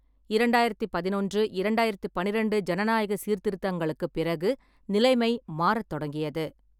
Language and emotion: Tamil, neutral